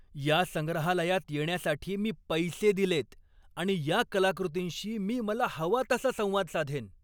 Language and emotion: Marathi, angry